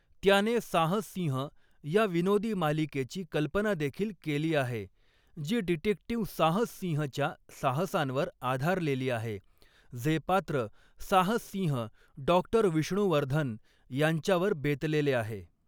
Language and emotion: Marathi, neutral